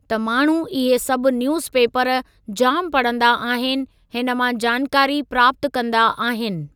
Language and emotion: Sindhi, neutral